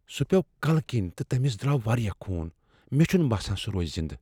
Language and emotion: Kashmiri, fearful